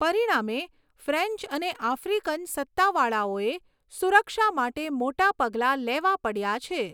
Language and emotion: Gujarati, neutral